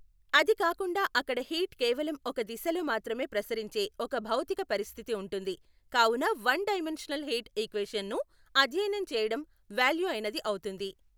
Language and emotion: Telugu, neutral